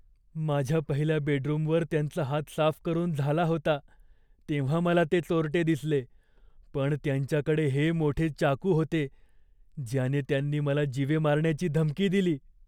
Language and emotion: Marathi, fearful